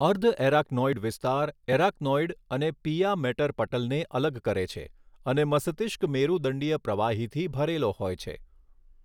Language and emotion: Gujarati, neutral